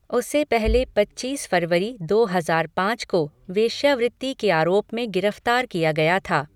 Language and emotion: Hindi, neutral